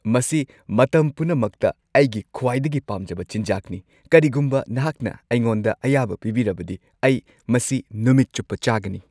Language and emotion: Manipuri, happy